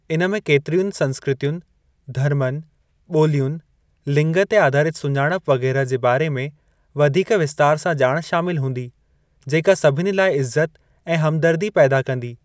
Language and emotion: Sindhi, neutral